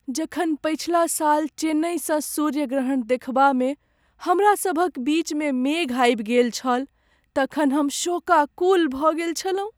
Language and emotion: Maithili, sad